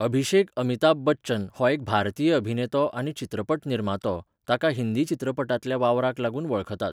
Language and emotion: Goan Konkani, neutral